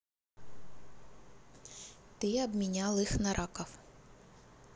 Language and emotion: Russian, neutral